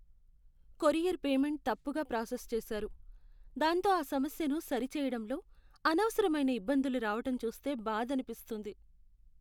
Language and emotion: Telugu, sad